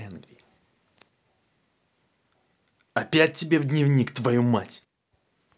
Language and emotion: Russian, angry